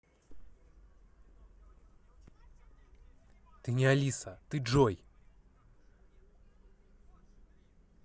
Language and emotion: Russian, angry